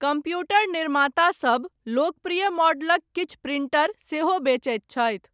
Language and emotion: Maithili, neutral